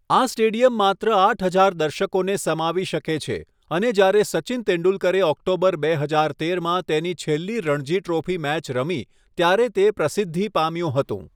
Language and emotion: Gujarati, neutral